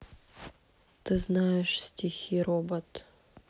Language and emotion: Russian, sad